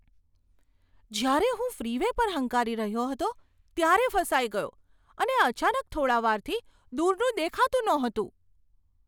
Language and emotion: Gujarati, surprised